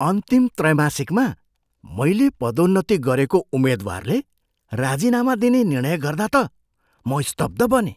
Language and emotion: Nepali, surprised